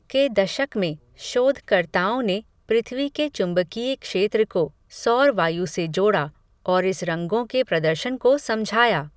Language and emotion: Hindi, neutral